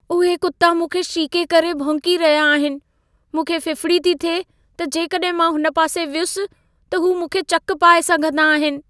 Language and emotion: Sindhi, fearful